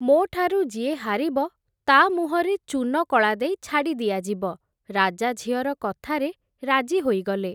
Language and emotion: Odia, neutral